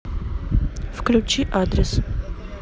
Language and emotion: Russian, neutral